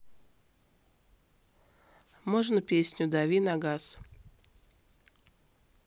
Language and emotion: Russian, neutral